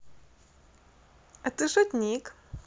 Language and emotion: Russian, positive